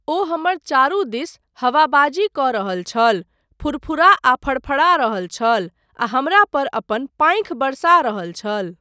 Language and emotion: Maithili, neutral